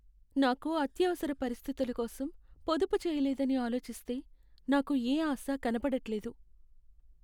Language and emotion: Telugu, sad